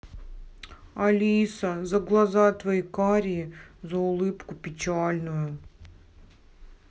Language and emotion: Russian, sad